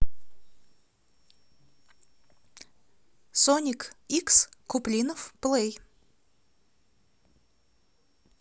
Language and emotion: Russian, positive